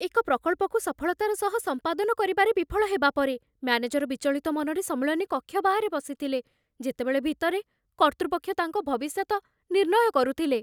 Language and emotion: Odia, fearful